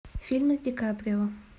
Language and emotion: Russian, neutral